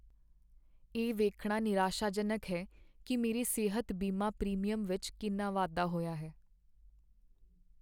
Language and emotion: Punjabi, sad